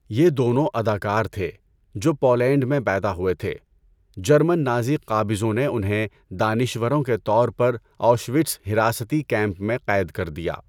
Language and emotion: Urdu, neutral